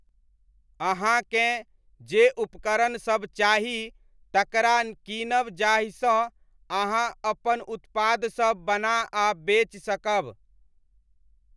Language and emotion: Maithili, neutral